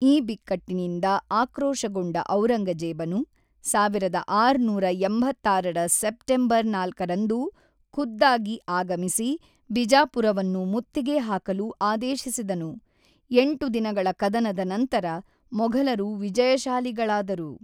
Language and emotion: Kannada, neutral